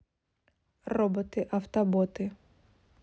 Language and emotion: Russian, neutral